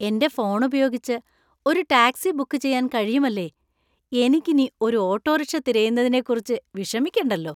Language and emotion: Malayalam, happy